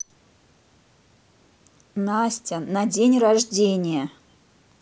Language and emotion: Russian, neutral